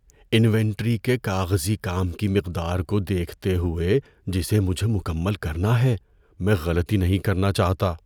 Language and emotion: Urdu, fearful